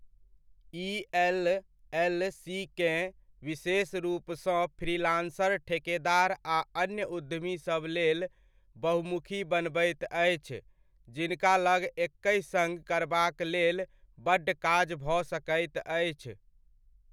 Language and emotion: Maithili, neutral